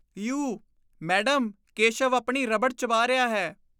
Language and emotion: Punjabi, disgusted